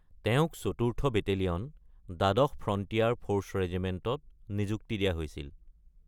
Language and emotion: Assamese, neutral